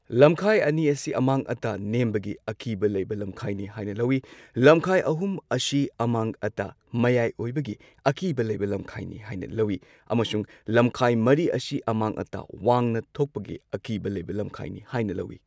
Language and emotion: Manipuri, neutral